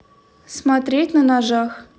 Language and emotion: Russian, neutral